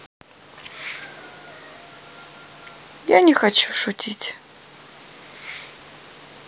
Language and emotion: Russian, sad